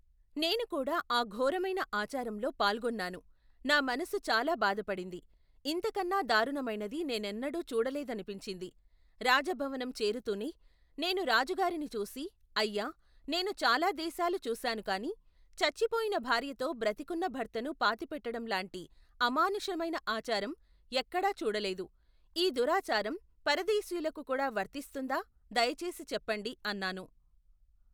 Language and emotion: Telugu, neutral